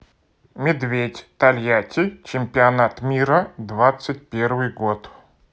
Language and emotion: Russian, neutral